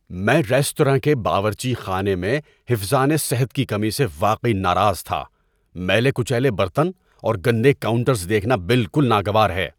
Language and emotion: Urdu, angry